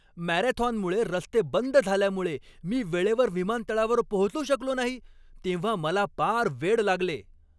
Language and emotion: Marathi, angry